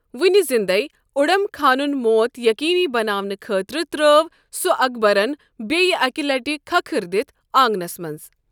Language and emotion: Kashmiri, neutral